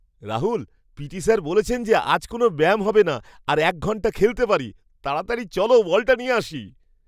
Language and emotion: Bengali, surprised